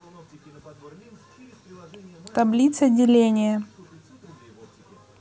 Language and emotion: Russian, neutral